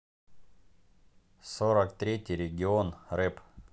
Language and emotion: Russian, neutral